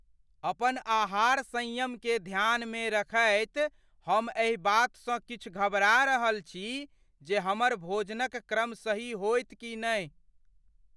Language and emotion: Maithili, fearful